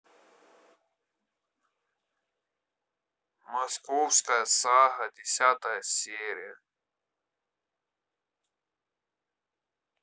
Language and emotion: Russian, neutral